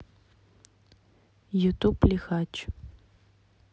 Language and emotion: Russian, neutral